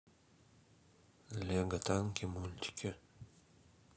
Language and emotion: Russian, neutral